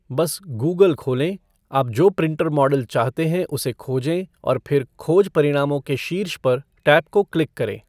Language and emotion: Hindi, neutral